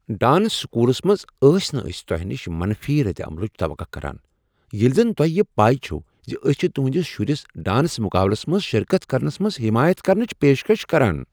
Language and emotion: Kashmiri, surprised